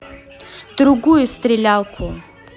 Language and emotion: Russian, angry